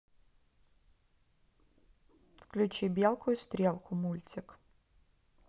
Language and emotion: Russian, neutral